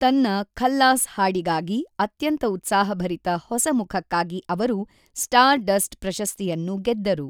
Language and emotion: Kannada, neutral